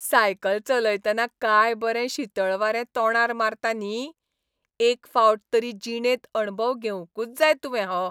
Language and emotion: Goan Konkani, happy